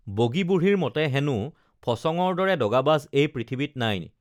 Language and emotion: Assamese, neutral